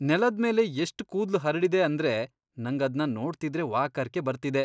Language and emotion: Kannada, disgusted